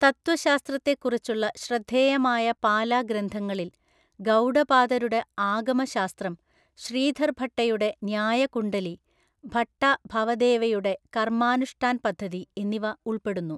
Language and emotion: Malayalam, neutral